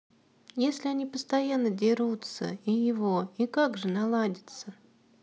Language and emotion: Russian, sad